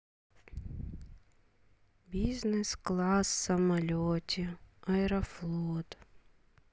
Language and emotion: Russian, sad